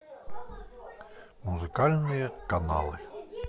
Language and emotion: Russian, neutral